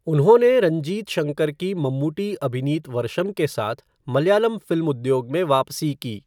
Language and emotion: Hindi, neutral